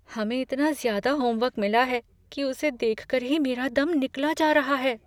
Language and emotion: Hindi, fearful